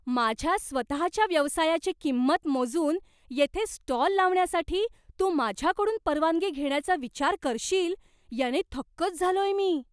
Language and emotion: Marathi, surprised